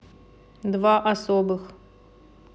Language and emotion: Russian, neutral